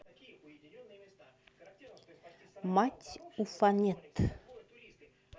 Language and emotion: Russian, neutral